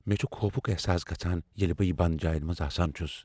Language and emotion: Kashmiri, fearful